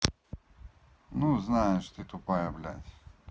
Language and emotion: Russian, neutral